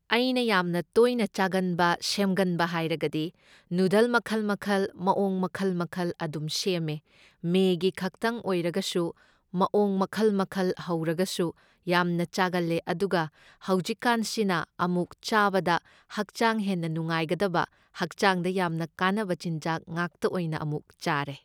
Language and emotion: Manipuri, neutral